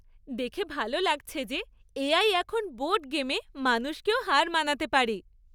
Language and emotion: Bengali, happy